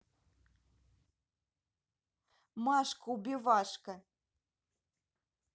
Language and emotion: Russian, positive